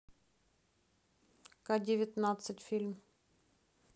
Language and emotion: Russian, neutral